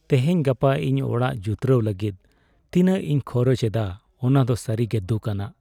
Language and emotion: Santali, sad